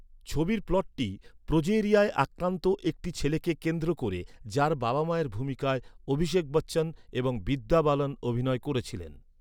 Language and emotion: Bengali, neutral